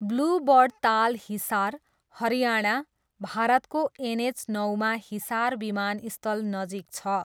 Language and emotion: Nepali, neutral